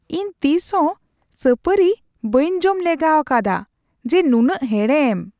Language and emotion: Santali, surprised